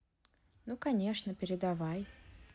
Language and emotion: Russian, neutral